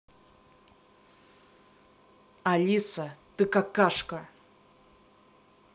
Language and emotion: Russian, angry